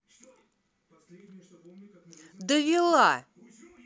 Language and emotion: Russian, angry